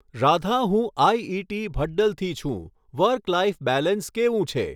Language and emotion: Gujarati, neutral